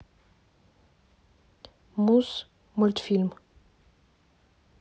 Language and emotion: Russian, neutral